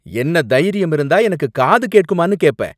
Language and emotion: Tamil, angry